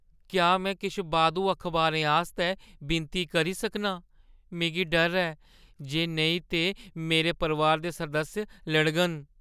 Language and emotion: Dogri, fearful